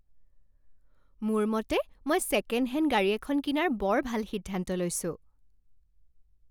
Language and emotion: Assamese, happy